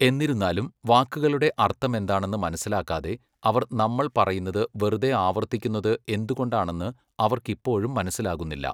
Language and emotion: Malayalam, neutral